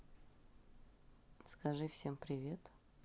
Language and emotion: Russian, neutral